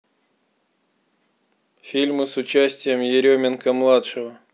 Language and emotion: Russian, neutral